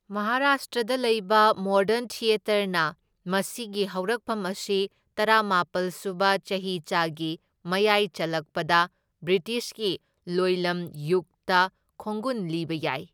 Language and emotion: Manipuri, neutral